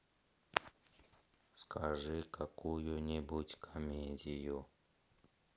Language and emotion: Russian, sad